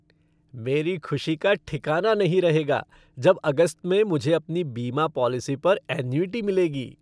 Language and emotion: Hindi, happy